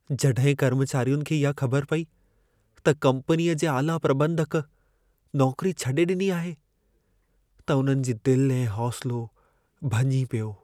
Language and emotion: Sindhi, sad